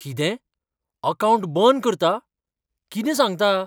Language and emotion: Goan Konkani, surprised